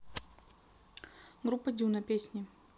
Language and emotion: Russian, neutral